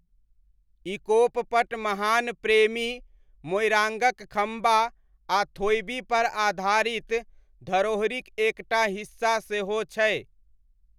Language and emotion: Maithili, neutral